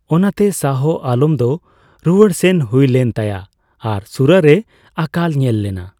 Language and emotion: Santali, neutral